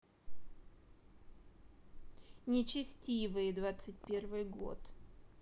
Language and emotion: Russian, neutral